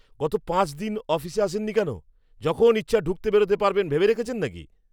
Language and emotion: Bengali, angry